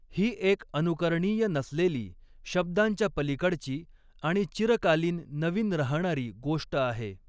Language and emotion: Marathi, neutral